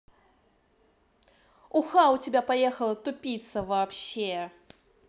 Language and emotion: Russian, angry